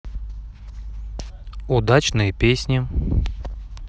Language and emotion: Russian, neutral